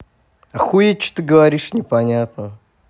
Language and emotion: Russian, angry